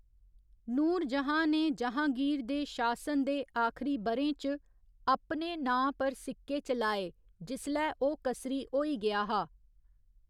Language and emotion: Dogri, neutral